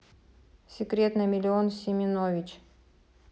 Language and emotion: Russian, neutral